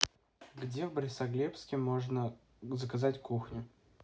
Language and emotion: Russian, neutral